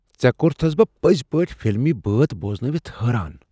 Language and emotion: Kashmiri, surprised